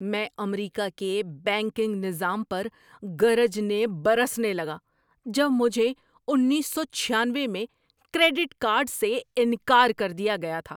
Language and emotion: Urdu, angry